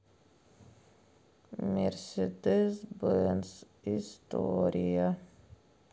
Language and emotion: Russian, sad